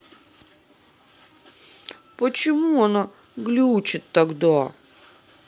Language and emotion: Russian, sad